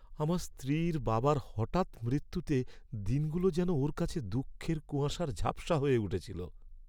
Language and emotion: Bengali, sad